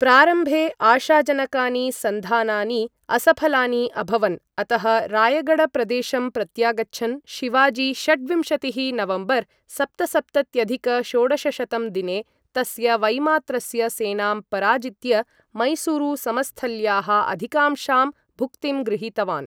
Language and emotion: Sanskrit, neutral